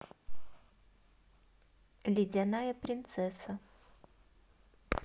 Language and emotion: Russian, neutral